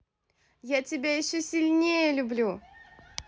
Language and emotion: Russian, positive